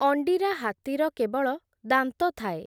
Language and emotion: Odia, neutral